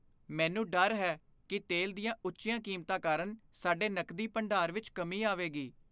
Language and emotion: Punjabi, fearful